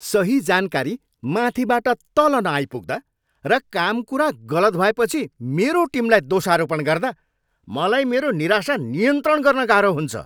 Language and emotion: Nepali, angry